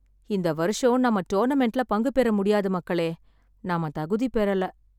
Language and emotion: Tamil, sad